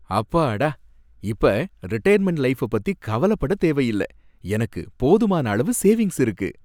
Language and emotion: Tamil, happy